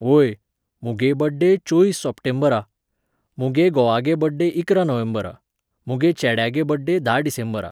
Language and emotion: Goan Konkani, neutral